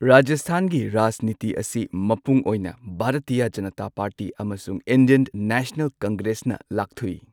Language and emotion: Manipuri, neutral